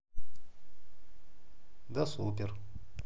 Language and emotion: Russian, neutral